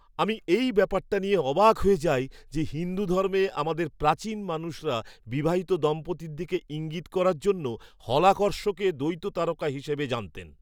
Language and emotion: Bengali, surprised